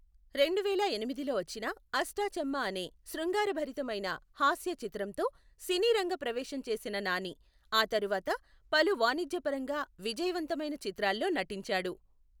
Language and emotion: Telugu, neutral